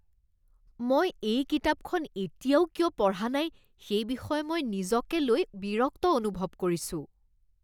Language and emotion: Assamese, disgusted